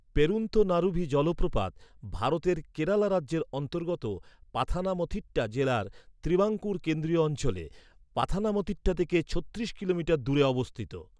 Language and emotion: Bengali, neutral